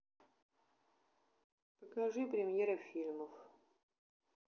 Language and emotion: Russian, neutral